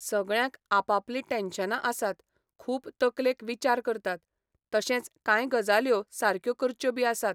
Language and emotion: Goan Konkani, neutral